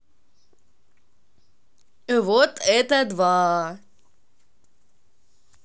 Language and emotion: Russian, positive